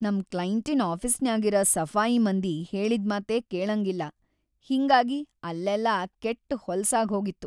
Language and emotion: Kannada, sad